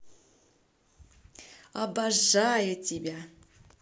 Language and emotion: Russian, positive